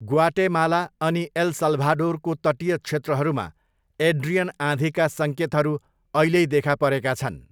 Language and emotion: Nepali, neutral